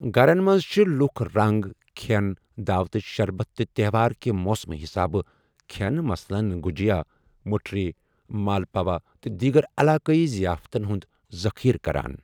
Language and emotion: Kashmiri, neutral